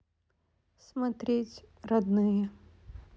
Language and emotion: Russian, sad